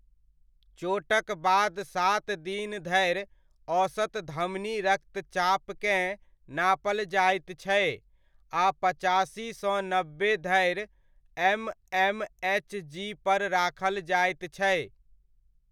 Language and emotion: Maithili, neutral